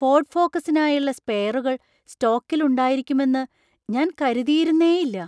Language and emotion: Malayalam, surprised